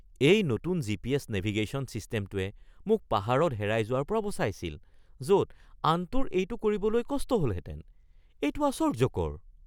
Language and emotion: Assamese, surprised